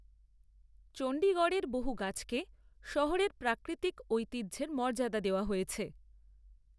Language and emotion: Bengali, neutral